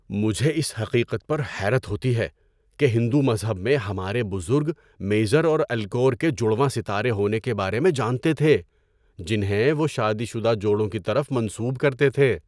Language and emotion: Urdu, surprised